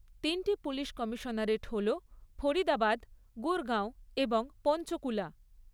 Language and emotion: Bengali, neutral